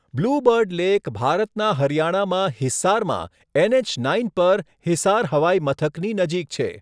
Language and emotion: Gujarati, neutral